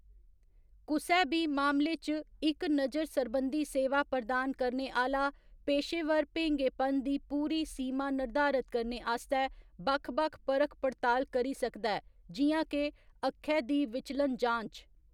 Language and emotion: Dogri, neutral